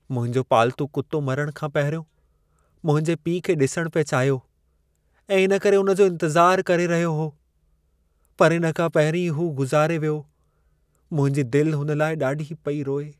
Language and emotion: Sindhi, sad